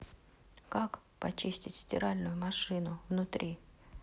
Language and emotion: Russian, neutral